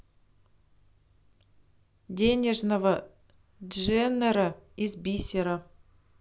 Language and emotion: Russian, neutral